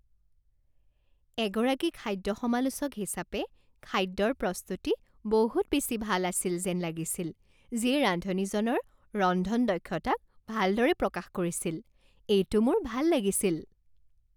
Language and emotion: Assamese, happy